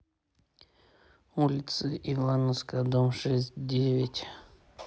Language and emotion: Russian, neutral